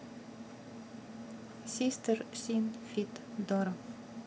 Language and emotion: Russian, neutral